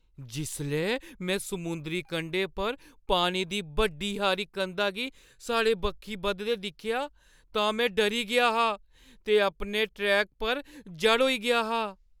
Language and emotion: Dogri, fearful